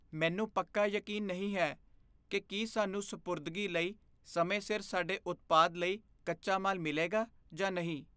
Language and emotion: Punjabi, fearful